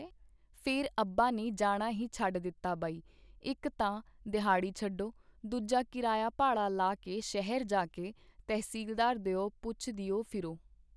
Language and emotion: Punjabi, neutral